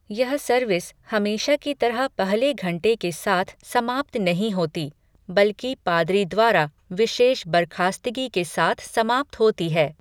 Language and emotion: Hindi, neutral